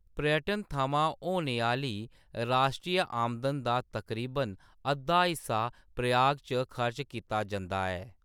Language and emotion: Dogri, neutral